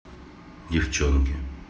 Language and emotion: Russian, neutral